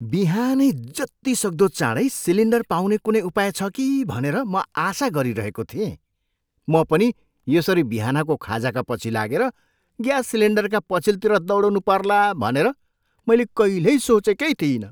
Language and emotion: Nepali, surprised